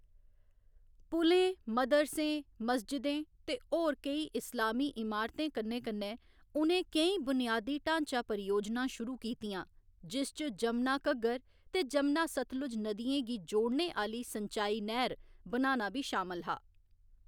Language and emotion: Dogri, neutral